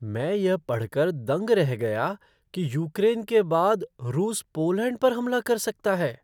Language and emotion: Hindi, surprised